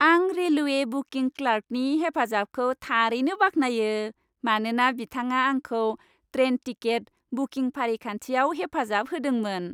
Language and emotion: Bodo, happy